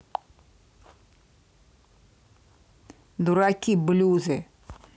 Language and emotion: Russian, angry